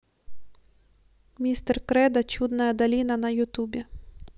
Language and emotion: Russian, neutral